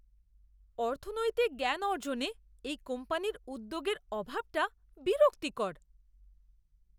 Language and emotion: Bengali, disgusted